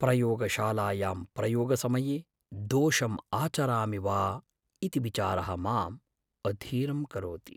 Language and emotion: Sanskrit, fearful